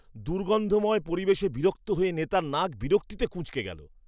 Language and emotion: Bengali, disgusted